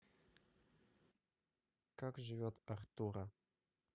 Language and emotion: Russian, sad